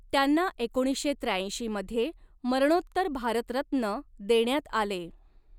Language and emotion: Marathi, neutral